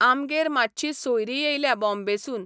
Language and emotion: Goan Konkani, neutral